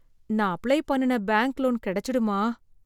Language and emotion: Tamil, fearful